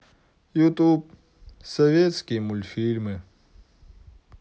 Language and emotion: Russian, sad